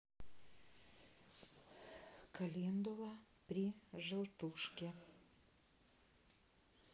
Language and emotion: Russian, neutral